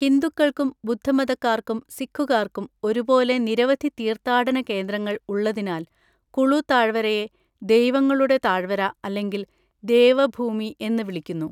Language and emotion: Malayalam, neutral